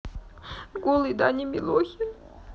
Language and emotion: Russian, sad